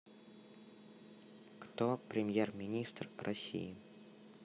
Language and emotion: Russian, neutral